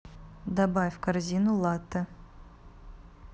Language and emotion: Russian, neutral